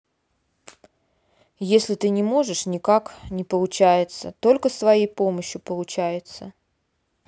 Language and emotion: Russian, neutral